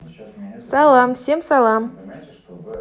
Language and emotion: Russian, positive